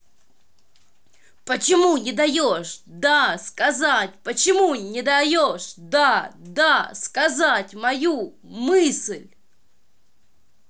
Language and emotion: Russian, angry